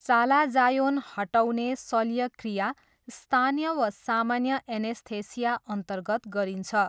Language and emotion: Nepali, neutral